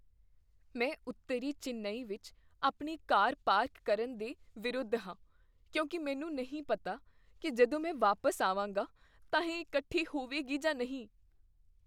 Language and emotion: Punjabi, fearful